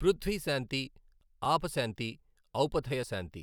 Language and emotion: Telugu, neutral